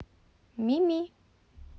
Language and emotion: Russian, neutral